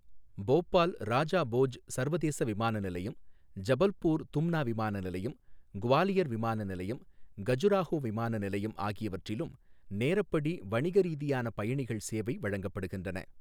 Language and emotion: Tamil, neutral